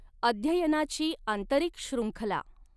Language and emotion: Marathi, neutral